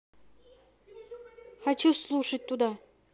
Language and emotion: Russian, neutral